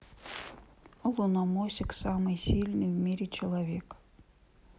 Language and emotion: Russian, neutral